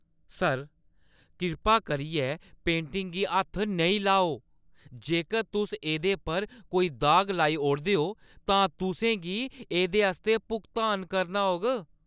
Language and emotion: Dogri, angry